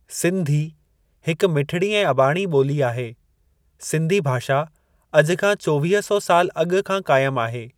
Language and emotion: Sindhi, neutral